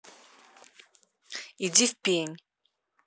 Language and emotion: Russian, angry